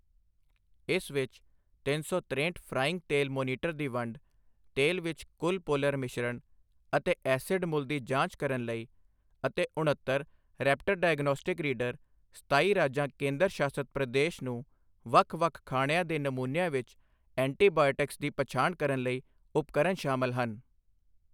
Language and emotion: Punjabi, neutral